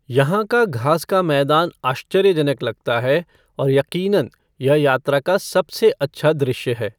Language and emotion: Hindi, neutral